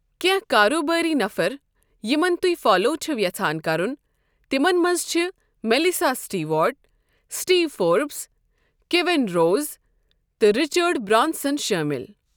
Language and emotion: Kashmiri, neutral